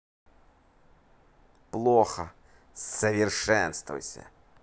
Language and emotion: Russian, neutral